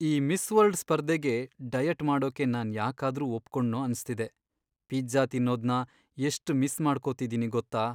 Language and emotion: Kannada, sad